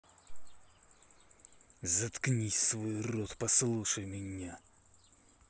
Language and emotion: Russian, angry